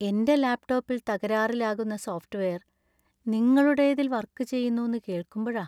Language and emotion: Malayalam, sad